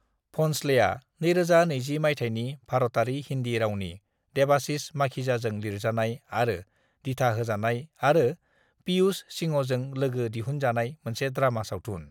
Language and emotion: Bodo, neutral